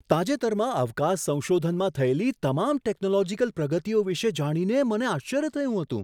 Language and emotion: Gujarati, surprised